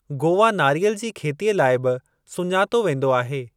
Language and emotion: Sindhi, neutral